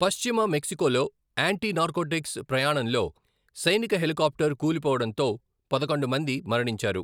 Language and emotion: Telugu, neutral